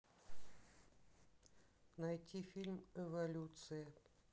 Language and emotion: Russian, neutral